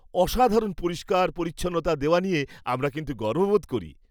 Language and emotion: Bengali, happy